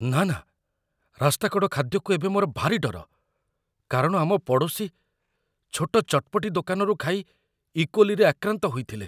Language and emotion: Odia, fearful